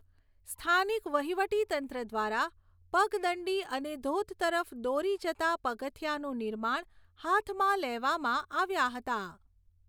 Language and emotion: Gujarati, neutral